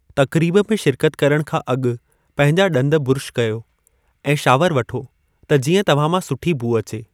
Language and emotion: Sindhi, neutral